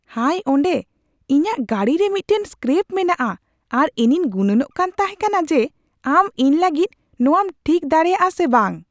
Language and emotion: Santali, surprised